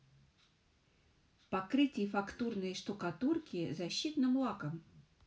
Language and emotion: Russian, neutral